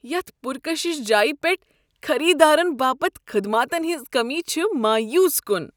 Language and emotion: Kashmiri, disgusted